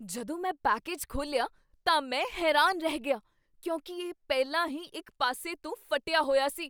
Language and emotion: Punjabi, surprised